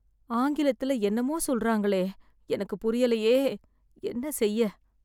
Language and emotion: Tamil, sad